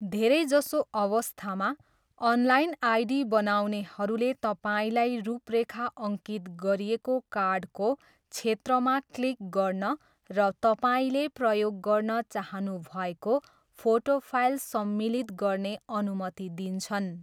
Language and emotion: Nepali, neutral